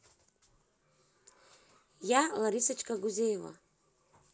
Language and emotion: Russian, positive